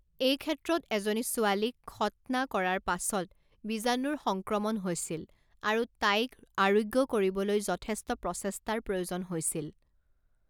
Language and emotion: Assamese, neutral